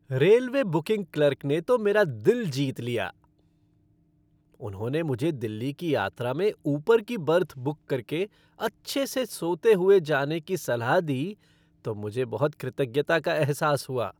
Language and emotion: Hindi, happy